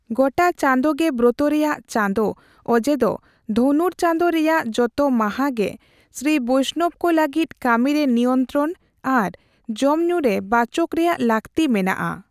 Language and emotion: Santali, neutral